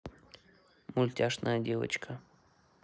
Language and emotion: Russian, neutral